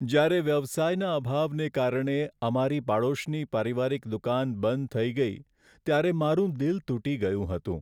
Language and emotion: Gujarati, sad